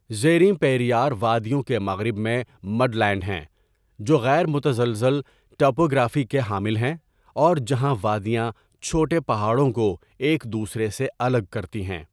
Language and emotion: Urdu, neutral